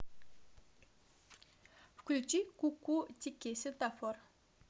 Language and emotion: Russian, neutral